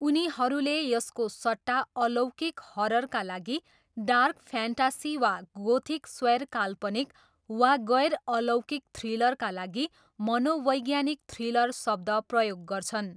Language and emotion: Nepali, neutral